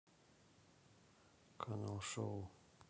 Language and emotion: Russian, neutral